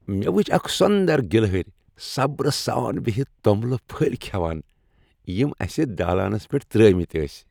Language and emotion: Kashmiri, happy